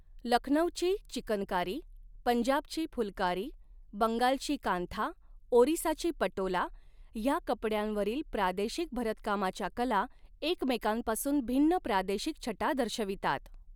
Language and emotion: Marathi, neutral